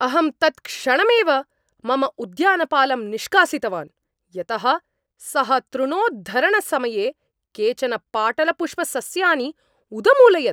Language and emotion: Sanskrit, angry